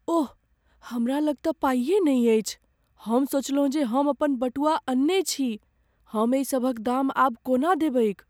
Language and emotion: Maithili, fearful